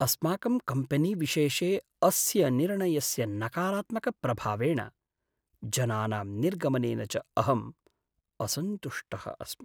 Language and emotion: Sanskrit, sad